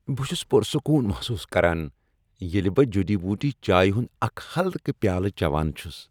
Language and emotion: Kashmiri, happy